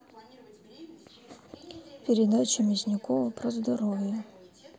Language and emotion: Russian, neutral